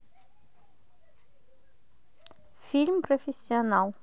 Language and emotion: Russian, neutral